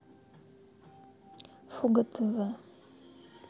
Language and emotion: Russian, sad